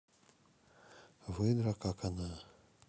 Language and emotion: Russian, neutral